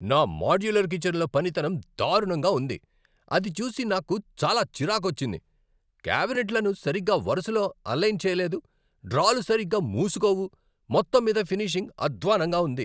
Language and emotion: Telugu, angry